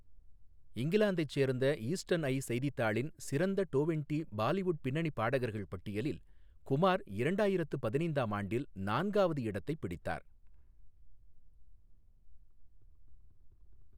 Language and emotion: Tamil, neutral